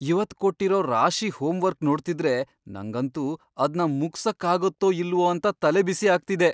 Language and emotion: Kannada, fearful